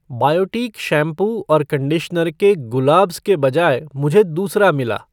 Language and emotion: Hindi, neutral